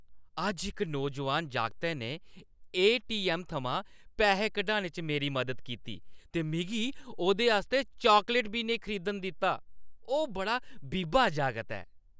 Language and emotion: Dogri, happy